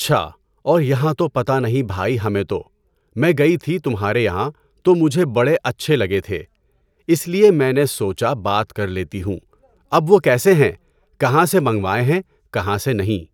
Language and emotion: Urdu, neutral